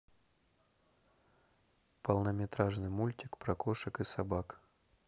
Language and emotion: Russian, neutral